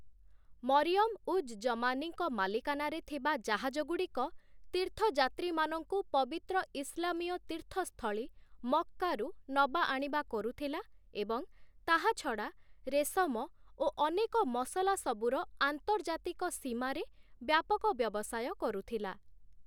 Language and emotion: Odia, neutral